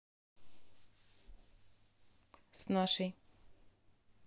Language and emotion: Russian, neutral